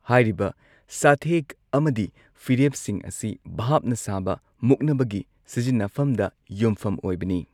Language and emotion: Manipuri, neutral